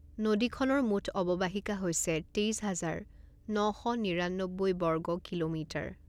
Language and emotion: Assamese, neutral